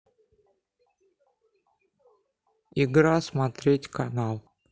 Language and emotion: Russian, neutral